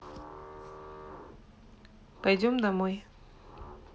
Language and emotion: Russian, neutral